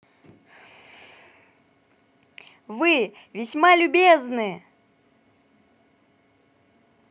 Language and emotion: Russian, positive